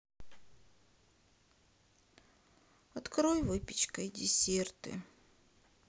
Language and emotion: Russian, sad